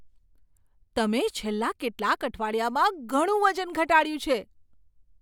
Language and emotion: Gujarati, surprised